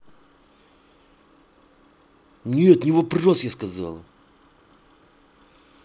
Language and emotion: Russian, angry